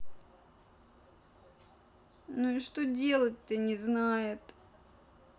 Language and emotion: Russian, sad